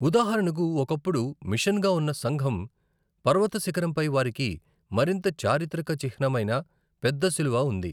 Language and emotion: Telugu, neutral